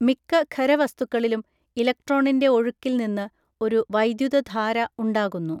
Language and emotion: Malayalam, neutral